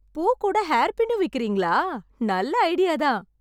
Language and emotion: Tamil, happy